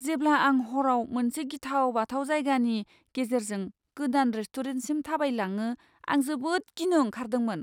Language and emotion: Bodo, fearful